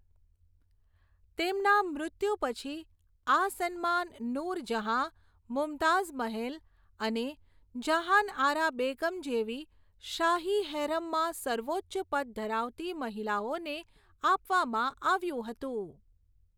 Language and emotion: Gujarati, neutral